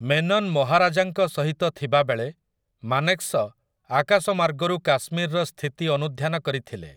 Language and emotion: Odia, neutral